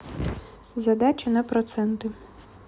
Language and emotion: Russian, neutral